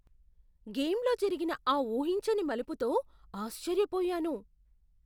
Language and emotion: Telugu, surprised